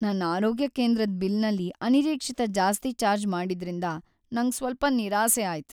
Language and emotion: Kannada, sad